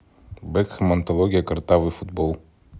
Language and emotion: Russian, neutral